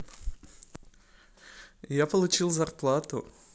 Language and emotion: Russian, positive